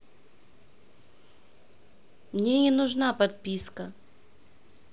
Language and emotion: Russian, neutral